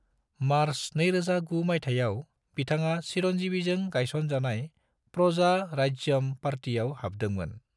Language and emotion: Bodo, neutral